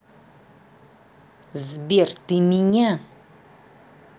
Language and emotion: Russian, angry